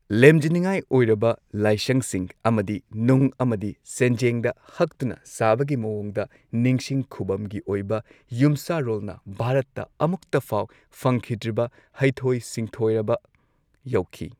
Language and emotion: Manipuri, neutral